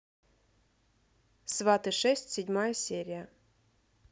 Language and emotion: Russian, neutral